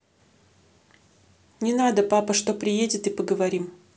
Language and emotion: Russian, neutral